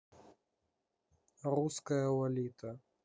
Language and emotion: Russian, neutral